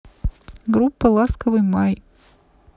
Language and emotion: Russian, neutral